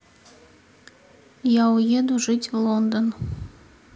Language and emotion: Russian, neutral